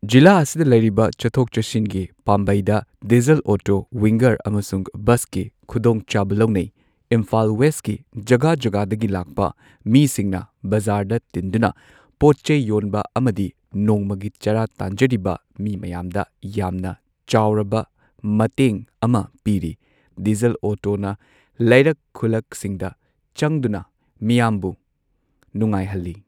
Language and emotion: Manipuri, neutral